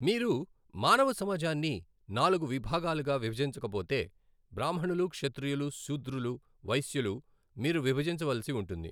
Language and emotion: Telugu, neutral